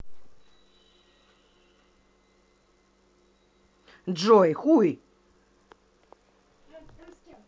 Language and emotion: Russian, angry